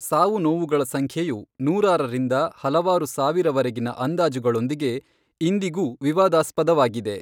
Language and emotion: Kannada, neutral